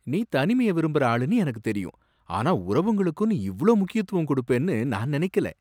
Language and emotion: Tamil, surprised